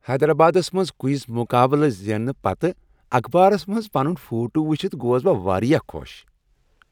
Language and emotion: Kashmiri, happy